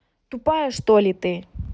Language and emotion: Russian, angry